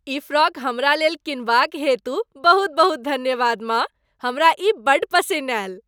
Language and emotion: Maithili, happy